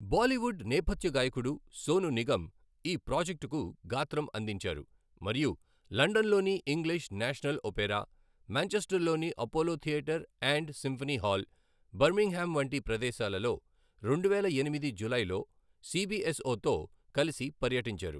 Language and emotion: Telugu, neutral